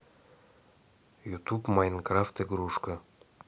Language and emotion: Russian, neutral